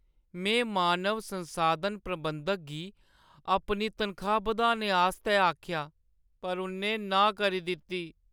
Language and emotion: Dogri, sad